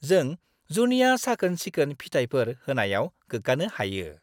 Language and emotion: Bodo, happy